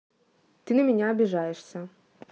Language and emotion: Russian, neutral